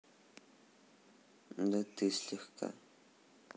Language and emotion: Russian, neutral